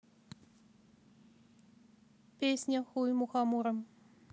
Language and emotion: Russian, neutral